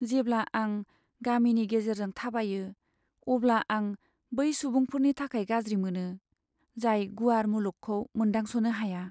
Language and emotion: Bodo, sad